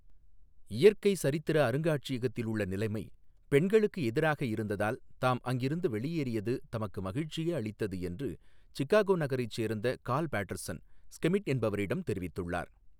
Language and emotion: Tamil, neutral